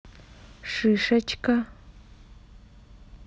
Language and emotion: Russian, neutral